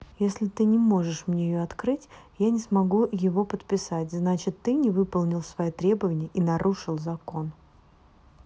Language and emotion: Russian, neutral